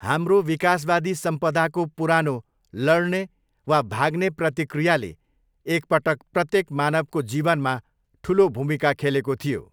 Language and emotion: Nepali, neutral